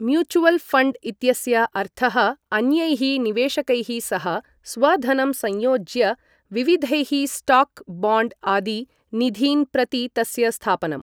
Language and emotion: Sanskrit, neutral